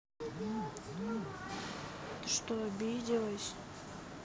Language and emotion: Russian, sad